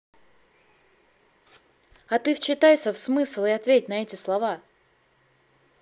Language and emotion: Russian, angry